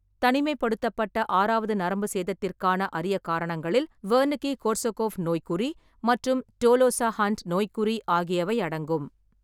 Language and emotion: Tamil, neutral